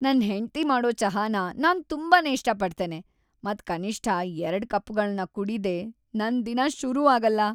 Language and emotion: Kannada, happy